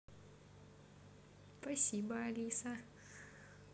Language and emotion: Russian, positive